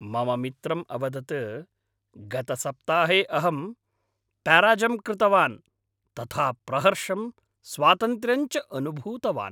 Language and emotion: Sanskrit, happy